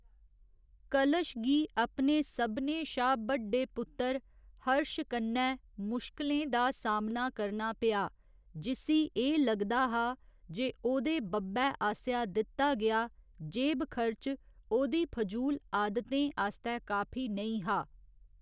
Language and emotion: Dogri, neutral